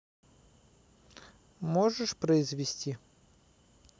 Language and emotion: Russian, neutral